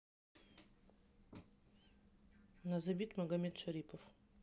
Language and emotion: Russian, neutral